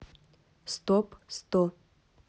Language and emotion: Russian, neutral